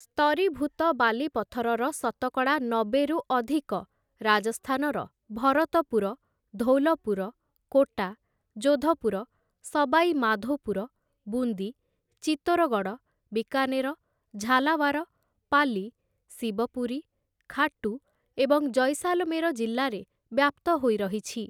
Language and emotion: Odia, neutral